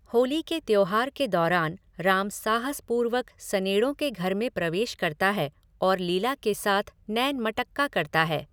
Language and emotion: Hindi, neutral